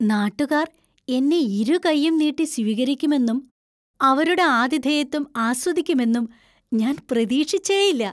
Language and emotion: Malayalam, surprised